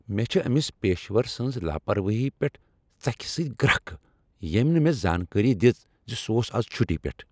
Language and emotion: Kashmiri, angry